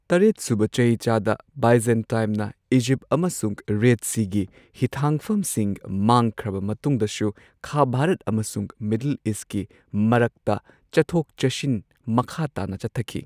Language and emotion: Manipuri, neutral